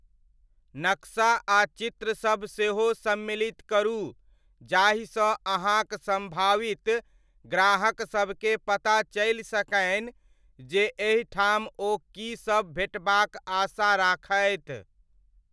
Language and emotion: Maithili, neutral